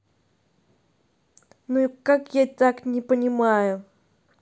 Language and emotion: Russian, angry